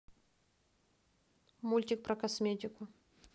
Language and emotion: Russian, neutral